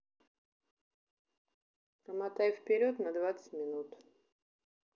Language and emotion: Russian, neutral